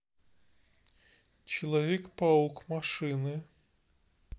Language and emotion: Russian, neutral